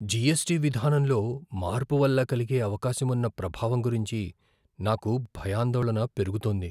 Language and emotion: Telugu, fearful